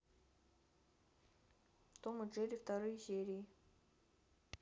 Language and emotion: Russian, neutral